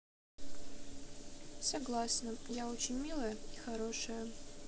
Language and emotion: Russian, neutral